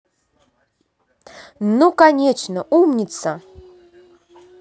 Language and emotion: Russian, positive